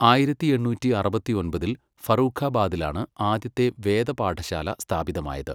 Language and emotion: Malayalam, neutral